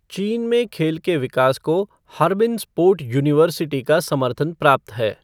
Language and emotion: Hindi, neutral